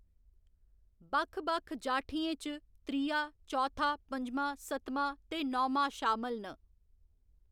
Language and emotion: Dogri, neutral